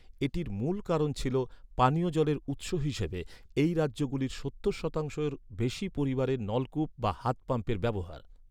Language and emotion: Bengali, neutral